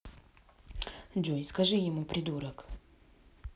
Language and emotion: Russian, neutral